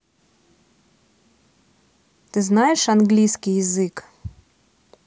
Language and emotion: Russian, neutral